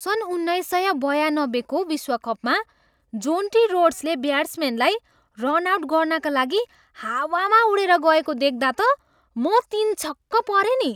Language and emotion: Nepali, surprised